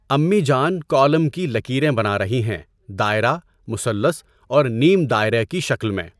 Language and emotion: Urdu, neutral